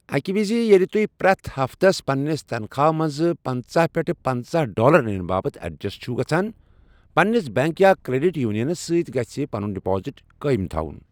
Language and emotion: Kashmiri, neutral